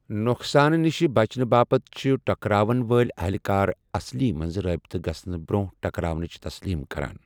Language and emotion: Kashmiri, neutral